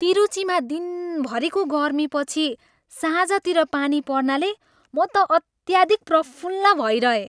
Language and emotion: Nepali, happy